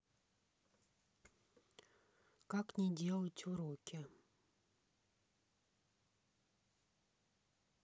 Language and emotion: Russian, neutral